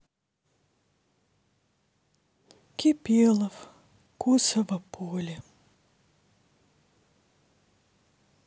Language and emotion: Russian, sad